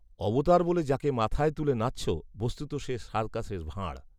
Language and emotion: Bengali, neutral